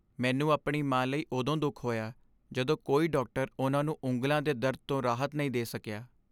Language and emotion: Punjabi, sad